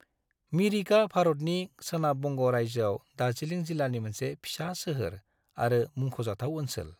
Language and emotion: Bodo, neutral